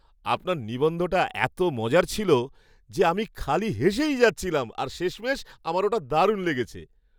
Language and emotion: Bengali, happy